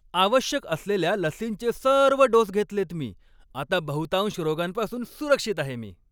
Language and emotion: Marathi, happy